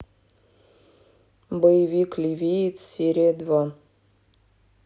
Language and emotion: Russian, neutral